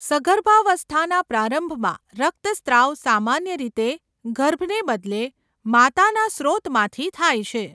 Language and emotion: Gujarati, neutral